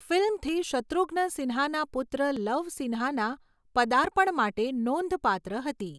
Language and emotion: Gujarati, neutral